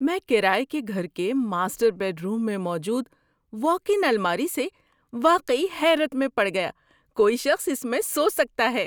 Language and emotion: Urdu, surprised